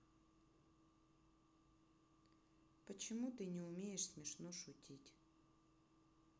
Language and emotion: Russian, neutral